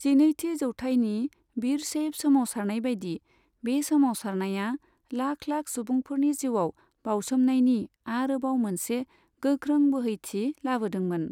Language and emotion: Bodo, neutral